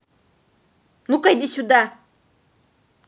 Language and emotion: Russian, angry